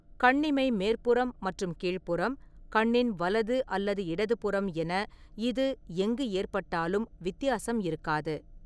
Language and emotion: Tamil, neutral